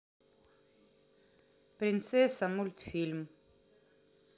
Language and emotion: Russian, neutral